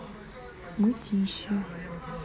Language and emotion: Russian, neutral